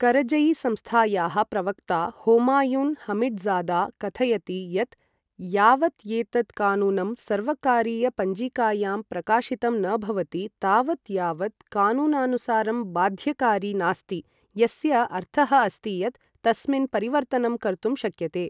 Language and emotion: Sanskrit, neutral